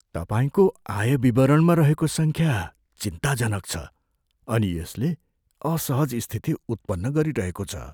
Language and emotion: Nepali, fearful